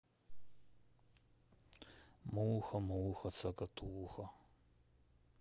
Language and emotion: Russian, sad